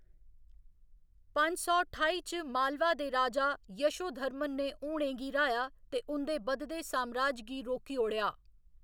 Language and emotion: Dogri, neutral